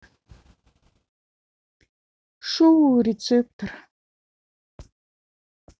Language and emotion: Russian, neutral